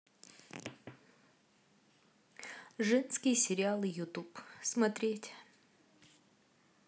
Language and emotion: Russian, neutral